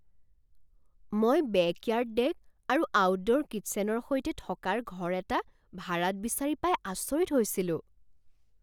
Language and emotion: Assamese, surprised